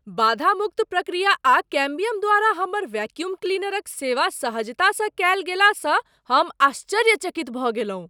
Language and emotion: Maithili, surprised